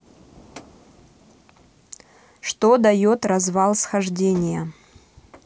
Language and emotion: Russian, neutral